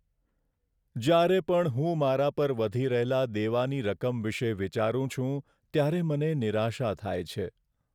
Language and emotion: Gujarati, sad